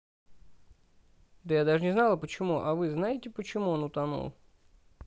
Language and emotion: Russian, neutral